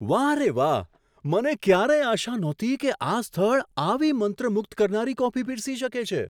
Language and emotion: Gujarati, surprised